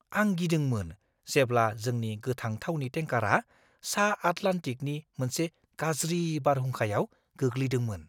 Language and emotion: Bodo, fearful